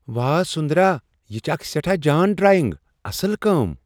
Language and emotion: Kashmiri, surprised